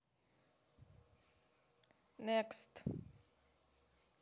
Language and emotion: Russian, neutral